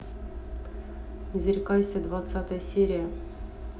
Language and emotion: Russian, neutral